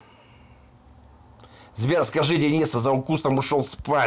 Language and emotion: Russian, angry